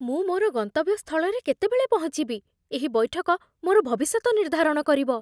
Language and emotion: Odia, fearful